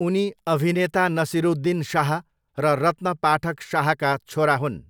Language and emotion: Nepali, neutral